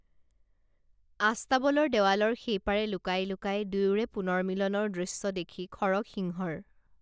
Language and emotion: Assamese, neutral